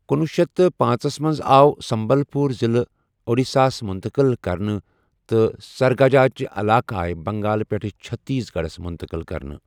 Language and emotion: Kashmiri, neutral